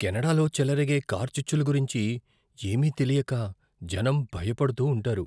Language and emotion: Telugu, fearful